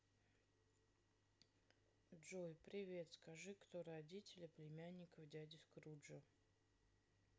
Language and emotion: Russian, neutral